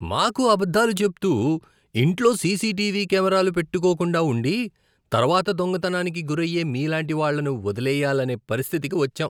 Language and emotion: Telugu, disgusted